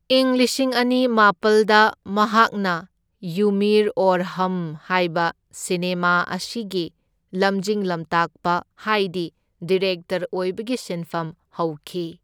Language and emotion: Manipuri, neutral